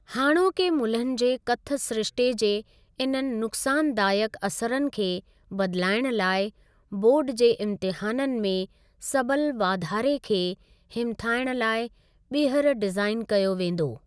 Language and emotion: Sindhi, neutral